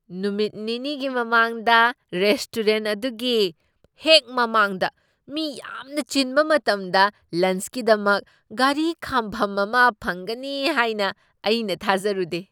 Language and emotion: Manipuri, surprised